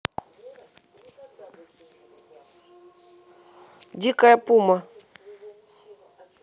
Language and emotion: Russian, neutral